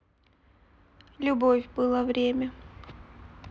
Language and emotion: Russian, sad